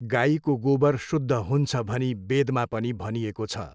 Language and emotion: Nepali, neutral